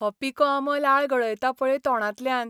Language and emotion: Goan Konkani, happy